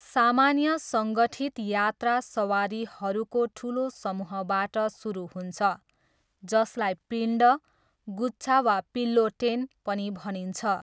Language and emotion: Nepali, neutral